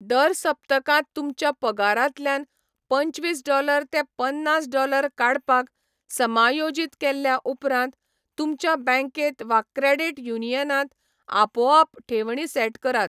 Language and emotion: Goan Konkani, neutral